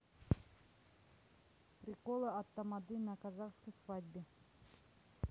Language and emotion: Russian, neutral